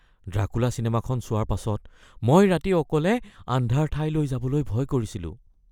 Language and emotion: Assamese, fearful